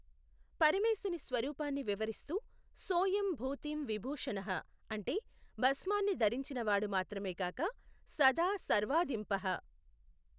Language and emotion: Telugu, neutral